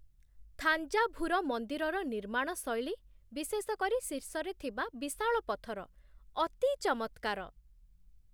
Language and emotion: Odia, surprised